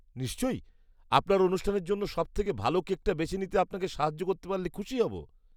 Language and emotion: Bengali, disgusted